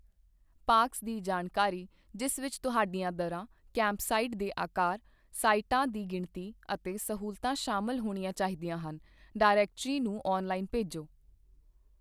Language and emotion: Punjabi, neutral